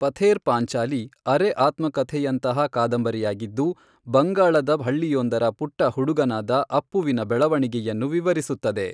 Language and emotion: Kannada, neutral